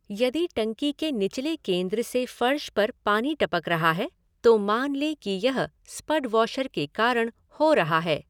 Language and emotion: Hindi, neutral